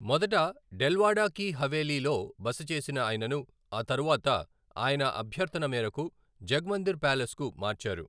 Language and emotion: Telugu, neutral